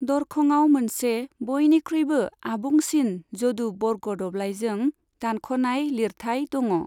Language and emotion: Bodo, neutral